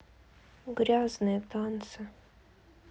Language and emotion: Russian, sad